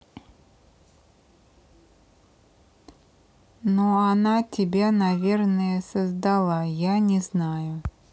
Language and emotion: Russian, neutral